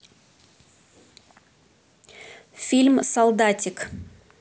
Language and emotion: Russian, neutral